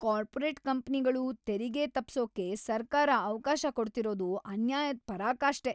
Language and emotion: Kannada, angry